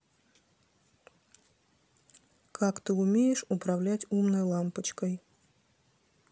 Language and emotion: Russian, neutral